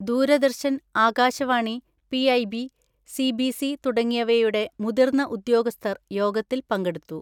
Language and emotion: Malayalam, neutral